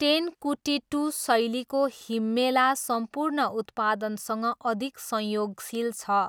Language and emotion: Nepali, neutral